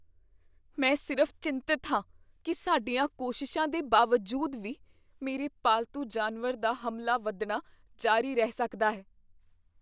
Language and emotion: Punjabi, fearful